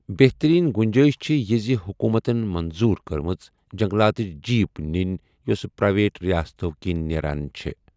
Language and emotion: Kashmiri, neutral